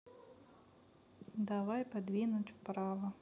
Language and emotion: Russian, sad